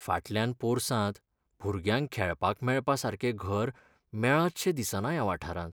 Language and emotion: Goan Konkani, sad